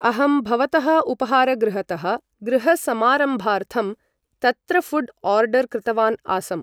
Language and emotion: Sanskrit, neutral